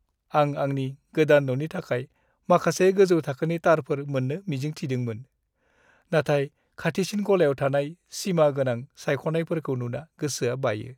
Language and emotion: Bodo, sad